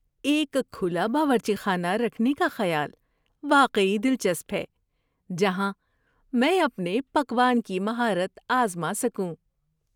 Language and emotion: Urdu, happy